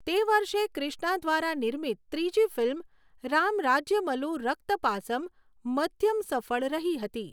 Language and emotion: Gujarati, neutral